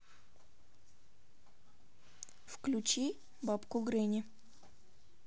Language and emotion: Russian, neutral